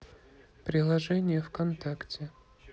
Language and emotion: Russian, neutral